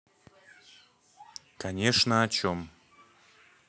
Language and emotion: Russian, neutral